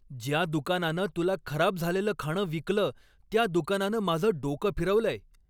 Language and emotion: Marathi, angry